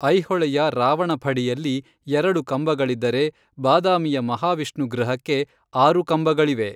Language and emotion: Kannada, neutral